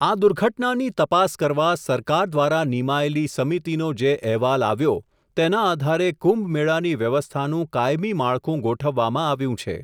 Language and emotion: Gujarati, neutral